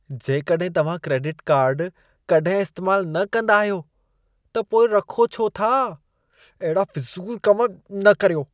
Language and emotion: Sindhi, disgusted